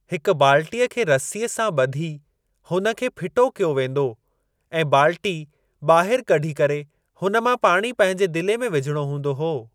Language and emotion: Sindhi, neutral